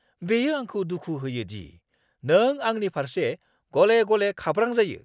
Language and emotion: Bodo, angry